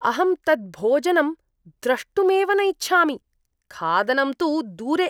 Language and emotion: Sanskrit, disgusted